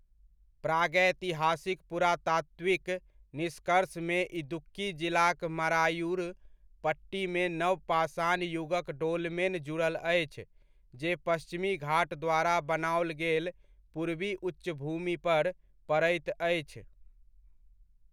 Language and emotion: Maithili, neutral